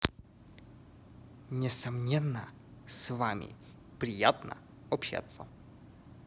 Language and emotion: Russian, positive